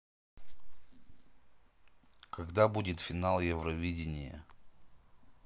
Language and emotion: Russian, neutral